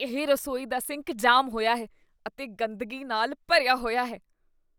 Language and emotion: Punjabi, disgusted